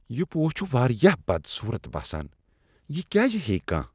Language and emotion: Kashmiri, disgusted